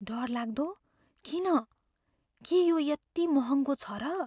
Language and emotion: Nepali, fearful